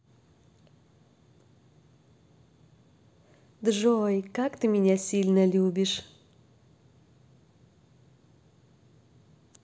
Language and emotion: Russian, positive